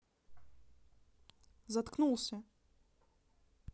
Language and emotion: Russian, neutral